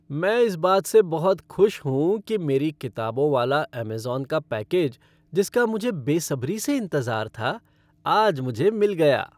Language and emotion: Hindi, happy